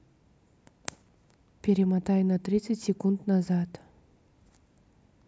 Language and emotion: Russian, neutral